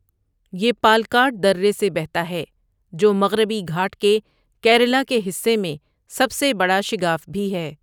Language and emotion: Urdu, neutral